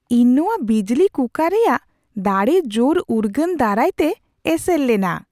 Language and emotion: Santali, surprised